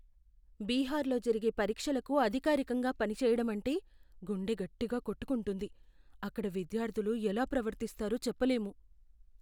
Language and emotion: Telugu, fearful